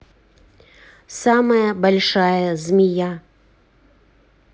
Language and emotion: Russian, neutral